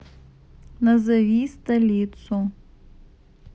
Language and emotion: Russian, neutral